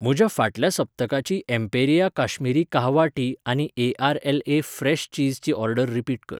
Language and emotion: Goan Konkani, neutral